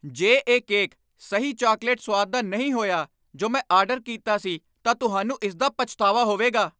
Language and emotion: Punjabi, angry